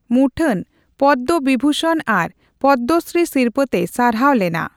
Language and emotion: Santali, neutral